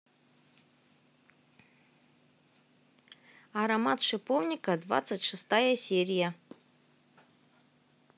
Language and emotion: Russian, positive